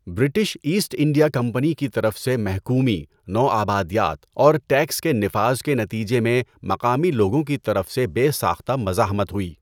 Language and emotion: Urdu, neutral